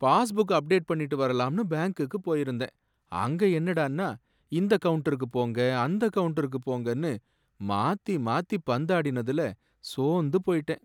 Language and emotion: Tamil, sad